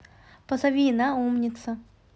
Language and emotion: Russian, neutral